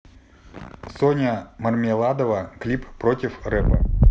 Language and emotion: Russian, neutral